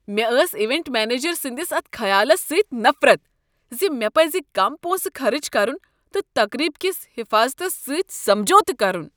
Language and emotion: Kashmiri, disgusted